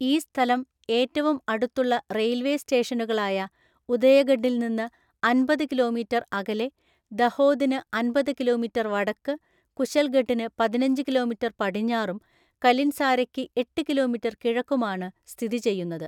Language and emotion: Malayalam, neutral